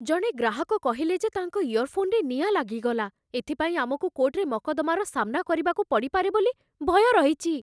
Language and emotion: Odia, fearful